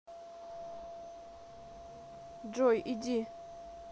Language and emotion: Russian, neutral